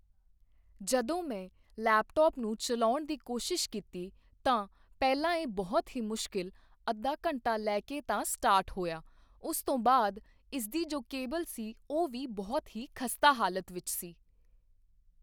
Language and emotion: Punjabi, neutral